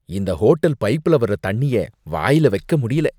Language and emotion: Tamil, disgusted